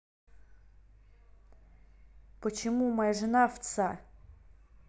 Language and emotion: Russian, angry